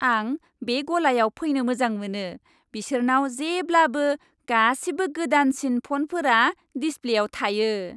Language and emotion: Bodo, happy